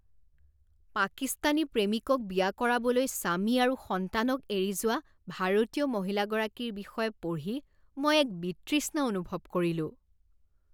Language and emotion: Assamese, disgusted